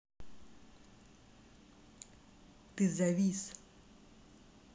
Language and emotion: Russian, neutral